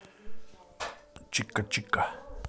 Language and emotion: Russian, positive